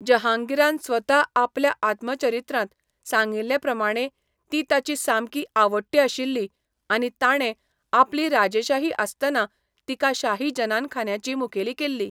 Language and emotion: Goan Konkani, neutral